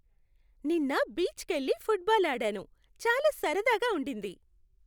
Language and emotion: Telugu, happy